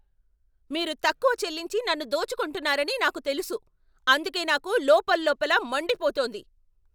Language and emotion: Telugu, angry